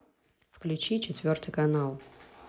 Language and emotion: Russian, neutral